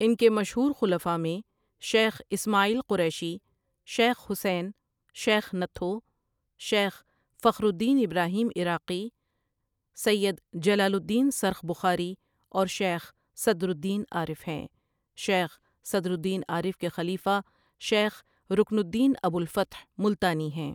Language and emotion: Urdu, neutral